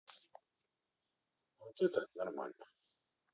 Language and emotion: Russian, neutral